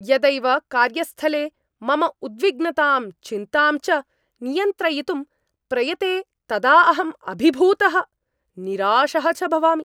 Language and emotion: Sanskrit, angry